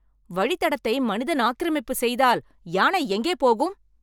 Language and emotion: Tamil, angry